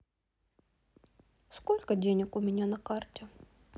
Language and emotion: Russian, neutral